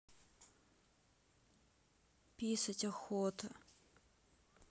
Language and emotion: Russian, sad